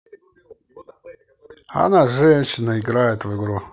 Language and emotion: Russian, neutral